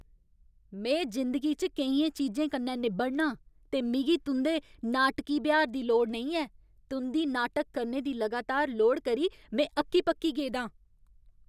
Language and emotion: Dogri, angry